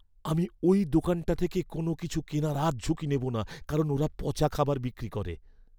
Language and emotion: Bengali, fearful